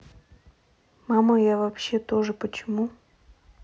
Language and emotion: Russian, sad